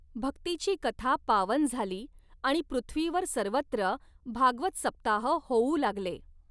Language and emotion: Marathi, neutral